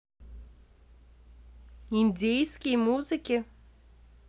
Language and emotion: Russian, neutral